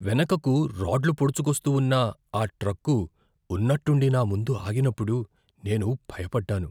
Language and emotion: Telugu, fearful